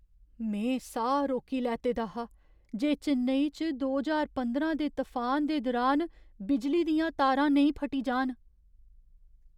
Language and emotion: Dogri, fearful